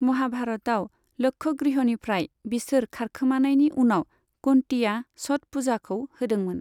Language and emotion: Bodo, neutral